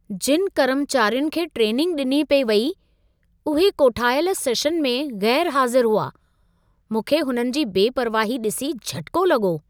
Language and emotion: Sindhi, surprised